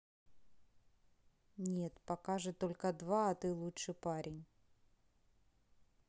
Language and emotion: Russian, neutral